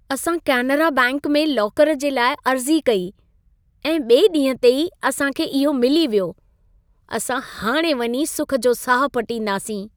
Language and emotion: Sindhi, happy